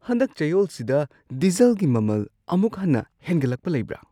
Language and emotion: Manipuri, surprised